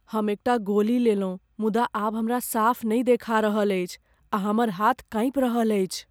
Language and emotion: Maithili, fearful